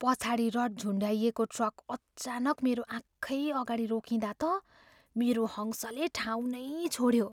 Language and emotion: Nepali, fearful